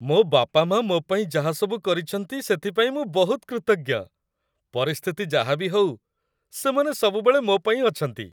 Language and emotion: Odia, happy